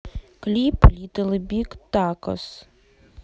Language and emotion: Russian, neutral